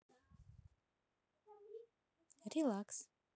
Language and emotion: Russian, neutral